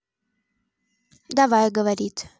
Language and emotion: Russian, neutral